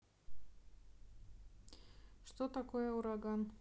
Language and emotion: Russian, neutral